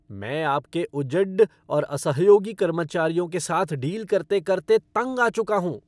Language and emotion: Hindi, angry